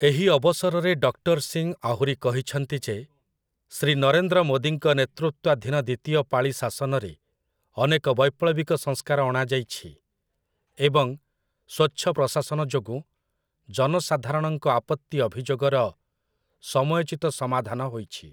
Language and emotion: Odia, neutral